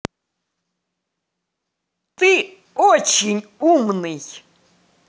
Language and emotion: Russian, positive